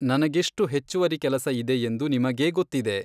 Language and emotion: Kannada, neutral